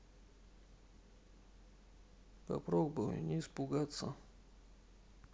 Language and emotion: Russian, sad